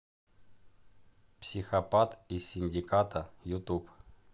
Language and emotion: Russian, neutral